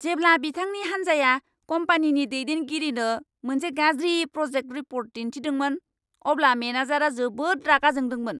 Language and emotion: Bodo, angry